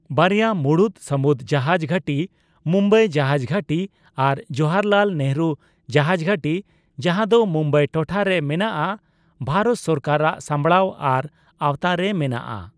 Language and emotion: Santali, neutral